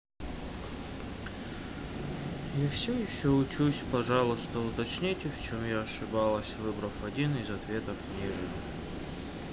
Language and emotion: Russian, sad